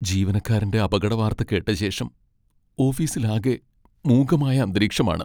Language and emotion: Malayalam, sad